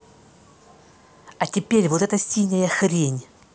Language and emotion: Russian, angry